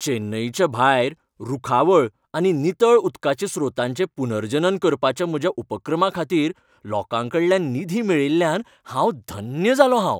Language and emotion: Goan Konkani, happy